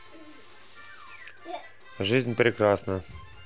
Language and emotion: Russian, neutral